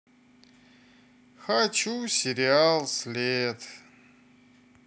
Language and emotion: Russian, sad